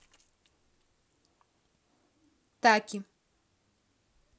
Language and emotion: Russian, neutral